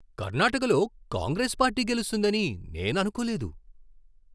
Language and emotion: Telugu, surprised